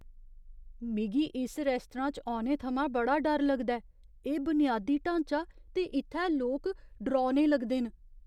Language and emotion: Dogri, fearful